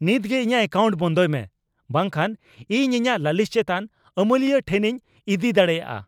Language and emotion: Santali, angry